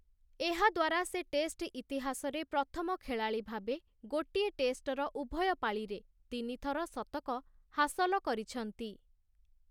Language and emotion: Odia, neutral